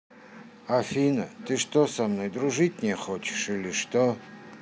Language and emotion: Russian, sad